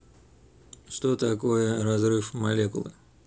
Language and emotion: Russian, neutral